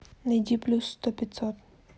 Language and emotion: Russian, neutral